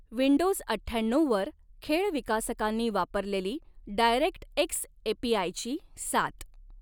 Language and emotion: Marathi, neutral